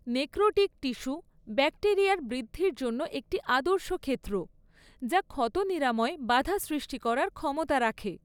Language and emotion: Bengali, neutral